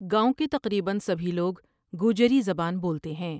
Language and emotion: Urdu, neutral